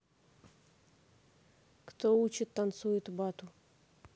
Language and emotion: Russian, neutral